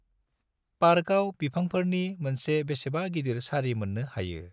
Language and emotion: Bodo, neutral